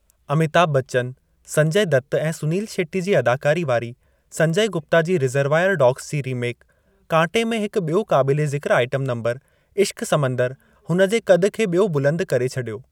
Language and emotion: Sindhi, neutral